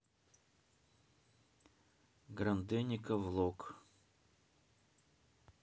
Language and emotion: Russian, neutral